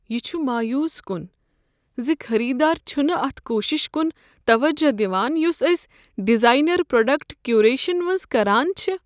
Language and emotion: Kashmiri, sad